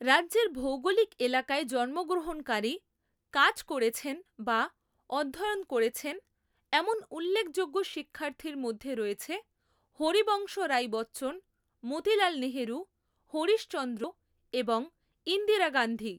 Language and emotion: Bengali, neutral